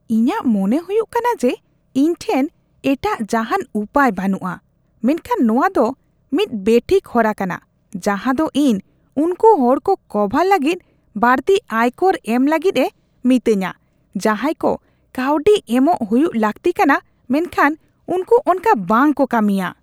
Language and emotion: Santali, disgusted